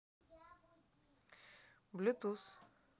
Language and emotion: Russian, neutral